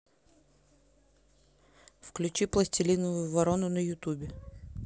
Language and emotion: Russian, neutral